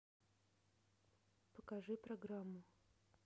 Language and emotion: Russian, neutral